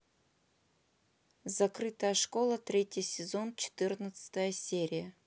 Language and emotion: Russian, neutral